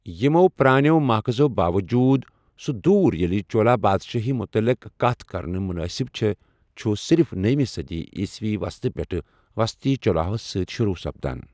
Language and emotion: Kashmiri, neutral